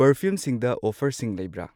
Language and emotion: Manipuri, neutral